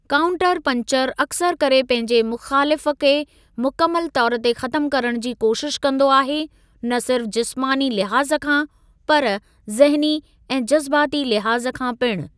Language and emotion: Sindhi, neutral